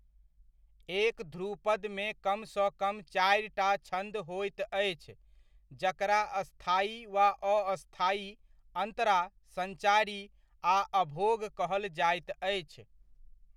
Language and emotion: Maithili, neutral